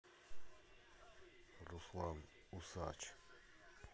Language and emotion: Russian, sad